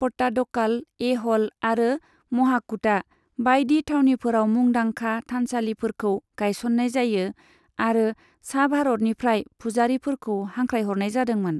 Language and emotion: Bodo, neutral